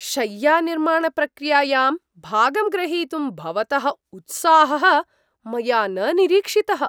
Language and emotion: Sanskrit, surprised